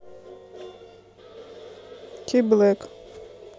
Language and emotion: Russian, neutral